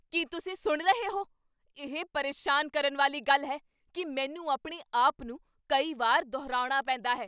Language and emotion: Punjabi, angry